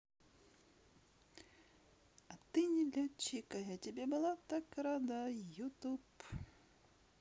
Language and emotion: Russian, positive